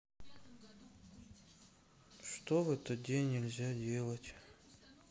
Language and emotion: Russian, sad